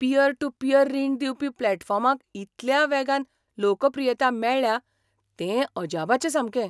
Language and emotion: Goan Konkani, surprised